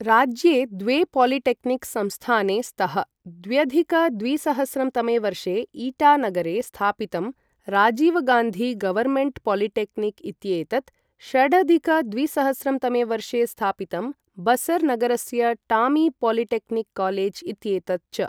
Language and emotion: Sanskrit, neutral